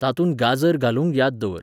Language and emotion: Goan Konkani, neutral